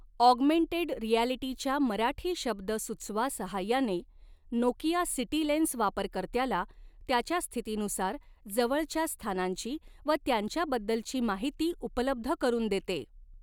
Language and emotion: Marathi, neutral